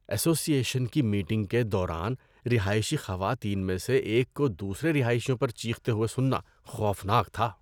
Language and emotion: Urdu, disgusted